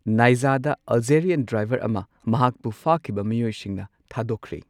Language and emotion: Manipuri, neutral